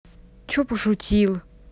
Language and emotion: Russian, angry